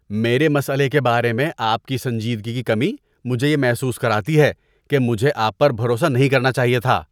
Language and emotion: Urdu, disgusted